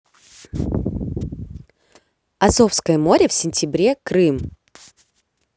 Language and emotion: Russian, positive